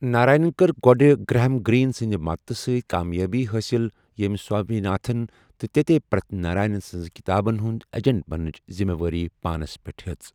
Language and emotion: Kashmiri, neutral